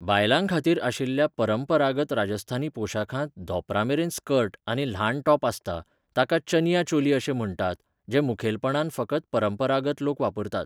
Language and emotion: Goan Konkani, neutral